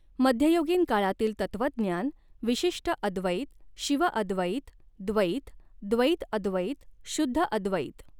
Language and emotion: Marathi, neutral